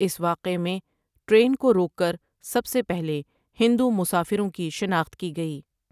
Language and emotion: Urdu, neutral